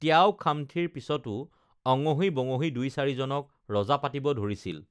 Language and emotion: Assamese, neutral